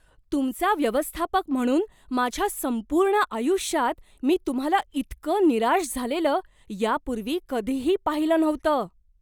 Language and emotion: Marathi, surprised